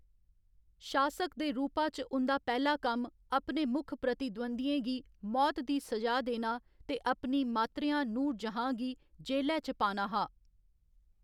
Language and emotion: Dogri, neutral